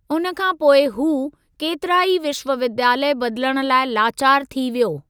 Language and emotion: Sindhi, neutral